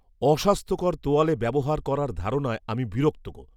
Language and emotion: Bengali, disgusted